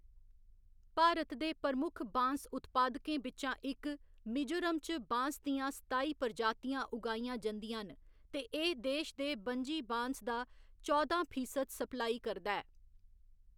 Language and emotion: Dogri, neutral